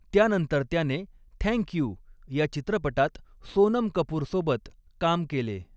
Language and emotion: Marathi, neutral